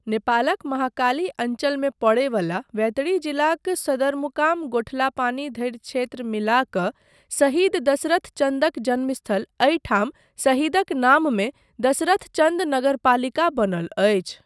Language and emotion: Maithili, neutral